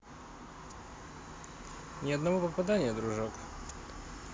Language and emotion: Russian, positive